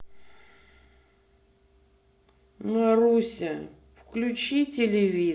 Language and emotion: Russian, angry